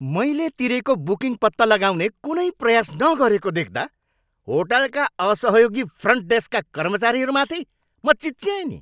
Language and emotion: Nepali, angry